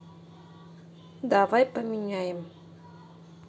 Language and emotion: Russian, neutral